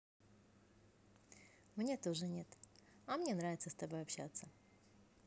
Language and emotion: Russian, positive